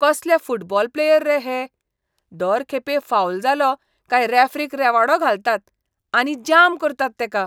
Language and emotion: Goan Konkani, disgusted